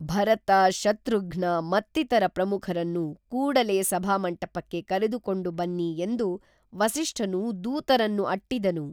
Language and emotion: Kannada, neutral